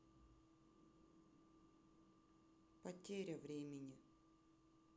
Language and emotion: Russian, sad